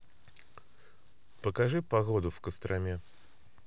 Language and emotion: Russian, neutral